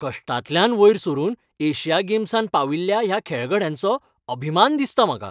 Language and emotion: Goan Konkani, happy